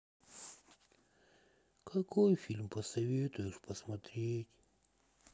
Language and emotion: Russian, sad